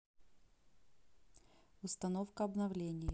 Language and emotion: Russian, neutral